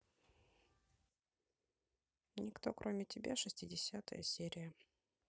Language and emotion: Russian, neutral